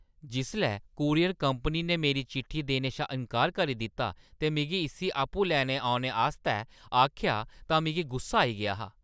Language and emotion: Dogri, angry